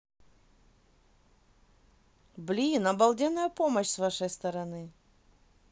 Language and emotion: Russian, positive